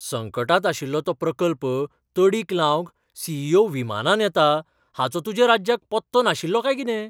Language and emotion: Goan Konkani, surprised